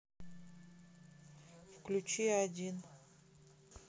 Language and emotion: Russian, neutral